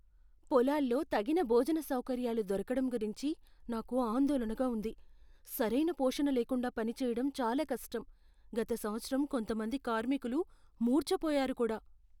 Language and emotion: Telugu, fearful